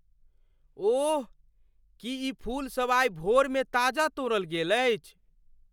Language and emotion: Maithili, surprised